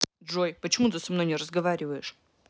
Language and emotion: Russian, neutral